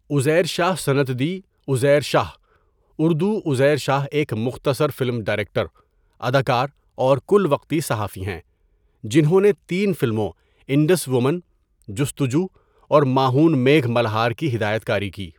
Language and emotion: Urdu, neutral